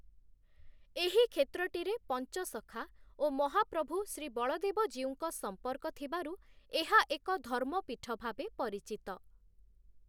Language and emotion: Odia, neutral